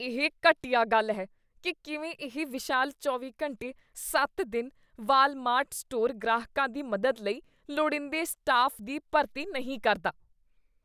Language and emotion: Punjabi, disgusted